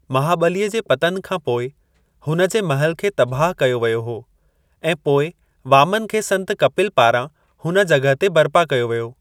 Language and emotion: Sindhi, neutral